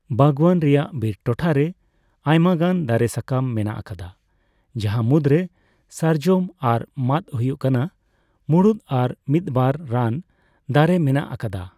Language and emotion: Santali, neutral